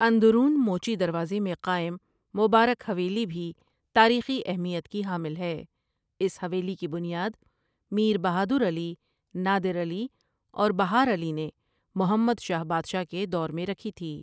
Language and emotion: Urdu, neutral